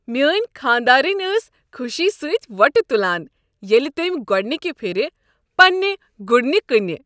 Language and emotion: Kashmiri, happy